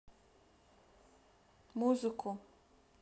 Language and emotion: Russian, neutral